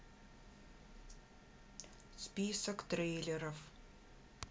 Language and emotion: Russian, neutral